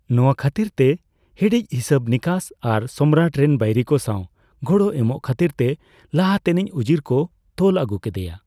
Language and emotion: Santali, neutral